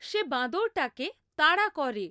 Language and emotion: Bengali, neutral